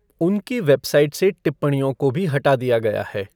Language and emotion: Hindi, neutral